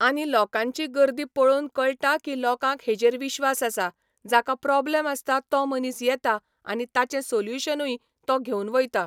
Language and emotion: Goan Konkani, neutral